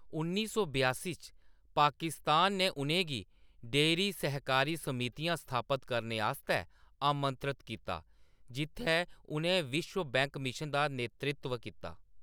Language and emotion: Dogri, neutral